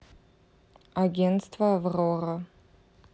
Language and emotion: Russian, neutral